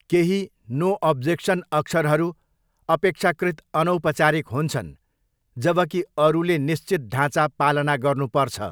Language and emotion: Nepali, neutral